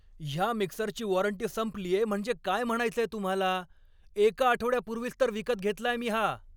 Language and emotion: Marathi, angry